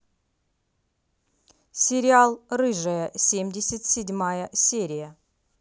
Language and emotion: Russian, neutral